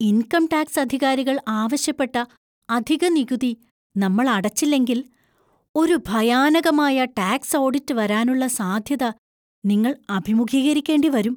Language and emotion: Malayalam, fearful